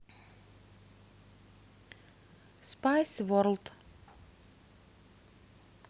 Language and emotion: Russian, neutral